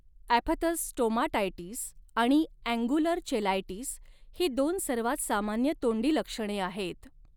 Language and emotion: Marathi, neutral